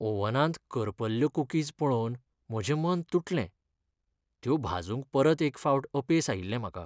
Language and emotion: Goan Konkani, sad